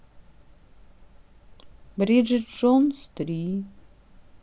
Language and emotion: Russian, sad